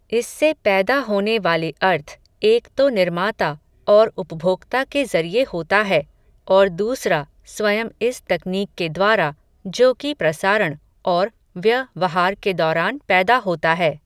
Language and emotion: Hindi, neutral